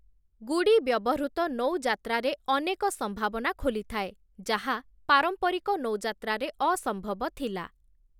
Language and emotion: Odia, neutral